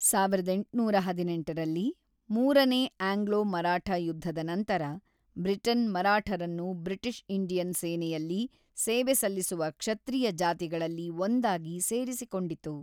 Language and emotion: Kannada, neutral